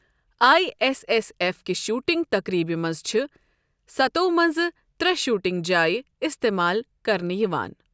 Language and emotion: Kashmiri, neutral